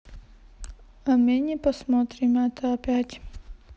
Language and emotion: Russian, sad